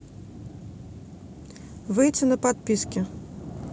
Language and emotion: Russian, neutral